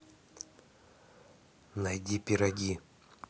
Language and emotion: Russian, neutral